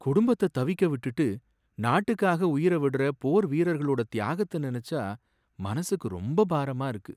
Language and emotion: Tamil, sad